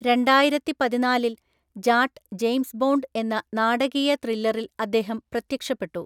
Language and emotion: Malayalam, neutral